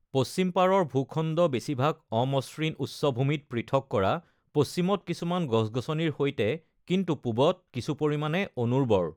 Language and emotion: Assamese, neutral